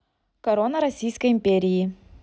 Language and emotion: Russian, neutral